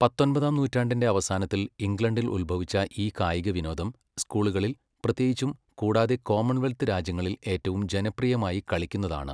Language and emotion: Malayalam, neutral